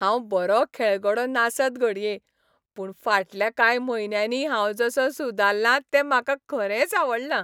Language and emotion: Goan Konkani, happy